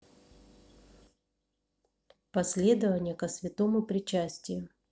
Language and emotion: Russian, neutral